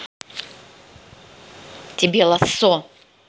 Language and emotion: Russian, angry